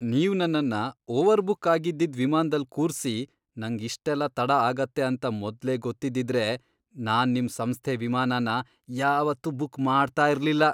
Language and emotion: Kannada, disgusted